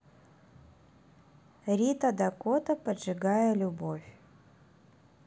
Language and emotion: Russian, neutral